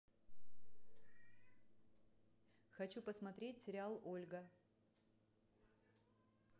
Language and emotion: Russian, neutral